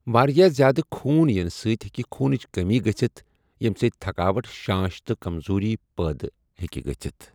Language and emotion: Kashmiri, neutral